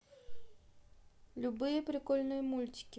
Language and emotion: Russian, neutral